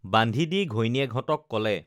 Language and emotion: Assamese, neutral